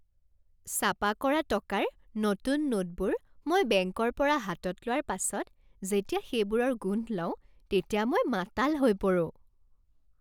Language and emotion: Assamese, happy